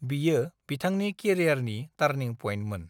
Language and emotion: Bodo, neutral